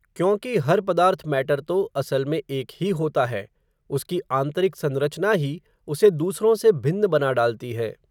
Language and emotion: Hindi, neutral